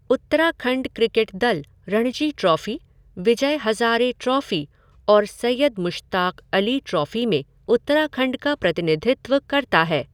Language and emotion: Hindi, neutral